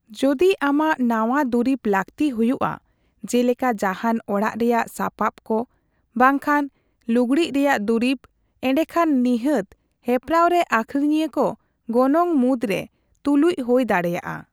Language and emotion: Santali, neutral